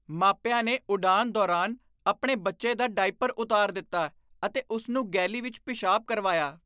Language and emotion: Punjabi, disgusted